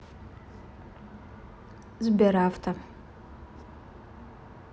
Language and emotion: Russian, neutral